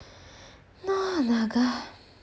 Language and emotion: Russian, sad